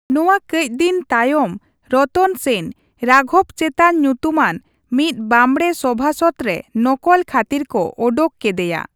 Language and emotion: Santali, neutral